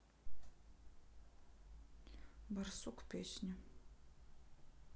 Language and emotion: Russian, neutral